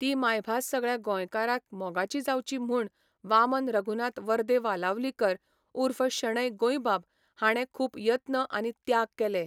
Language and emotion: Goan Konkani, neutral